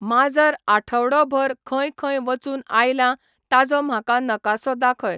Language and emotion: Goan Konkani, neutral